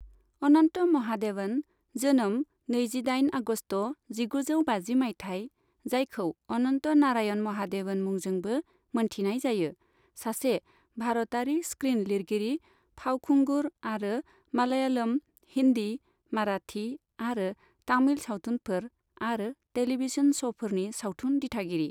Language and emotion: Bodo, neutral